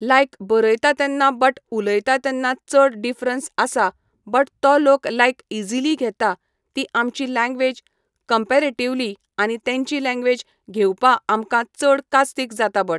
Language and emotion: Goan Konkani, neutral